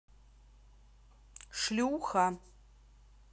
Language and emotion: Russian, angry